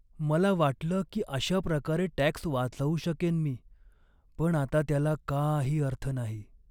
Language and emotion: Marathi, sad